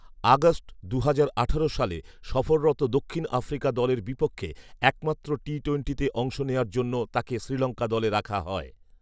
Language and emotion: Bengali, neutral